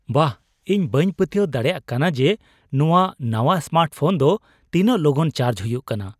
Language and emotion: Santali, surprised